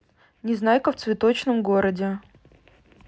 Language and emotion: Russian, neutral